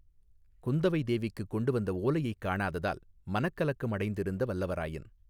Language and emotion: Tamil, neutral